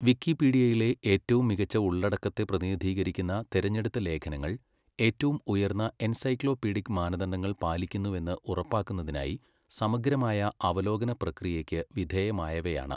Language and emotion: Malayalam, neutral